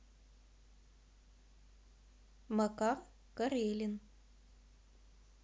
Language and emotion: Russian, neutral